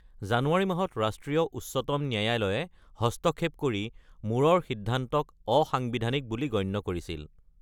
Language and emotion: Assamese, neutral